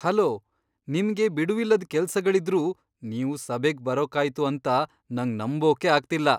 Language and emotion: Kannada, surprised